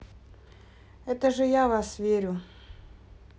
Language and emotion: Russian, neutral